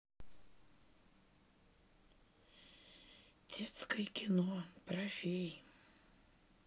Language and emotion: Russian, sad